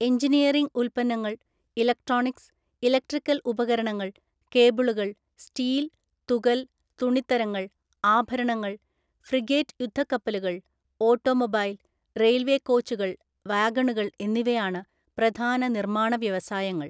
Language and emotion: Malayalam, neutral